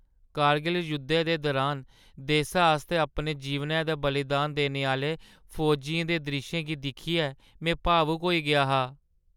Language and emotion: Dogri, sad